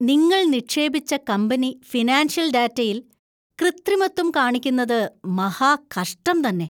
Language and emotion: Malayalam, disgusted